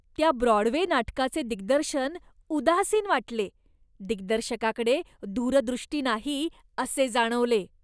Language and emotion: Marathi, disgusted